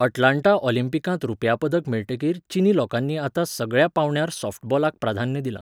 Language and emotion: Goan Konkani, neutral